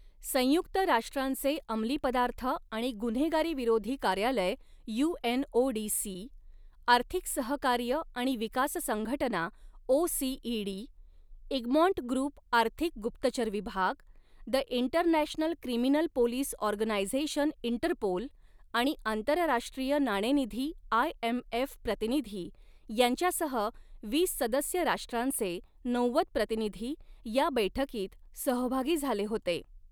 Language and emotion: Marathi, neutral